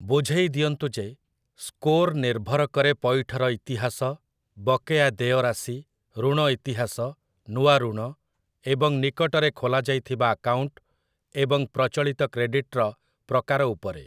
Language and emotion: Odia, neutral